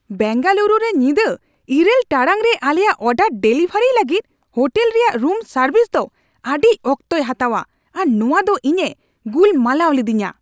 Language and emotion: Santali, angry